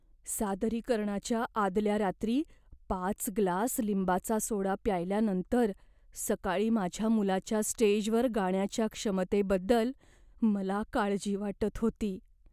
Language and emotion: Marathi, fearful